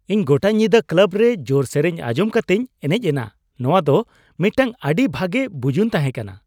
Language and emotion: Santali, happy